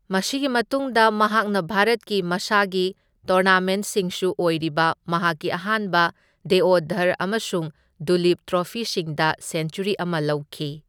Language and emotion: Manipuri, neutral